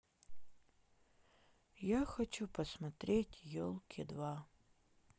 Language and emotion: Russian, sad